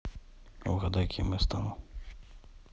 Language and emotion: Russian, neutral